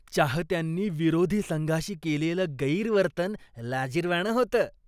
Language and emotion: Marathi, disgusted